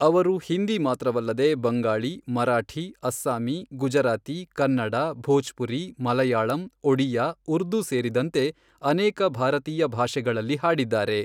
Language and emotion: Kannada, neutral